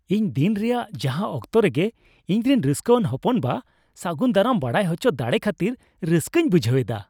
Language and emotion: Santali, happy